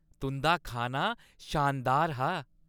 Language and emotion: Dogri, happy